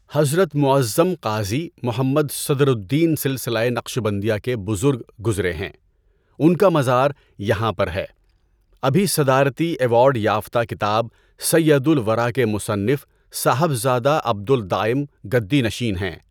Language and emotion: Urdu, neutral